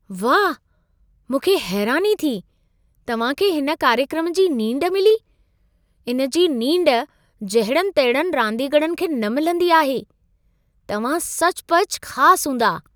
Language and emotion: Sindhi, surprised